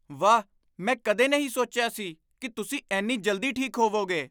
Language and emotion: Punjabi, surprised